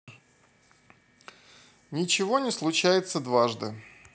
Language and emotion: Russian, neutral